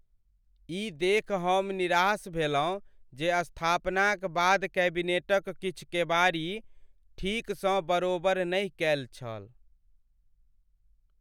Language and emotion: Maithili, sad